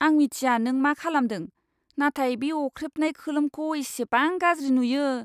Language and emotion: Bodo, disgusted